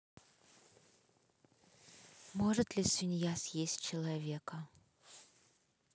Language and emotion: Russian, neutral